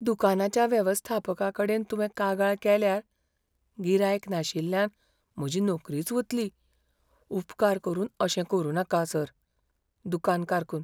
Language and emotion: Goan Konkani, fearful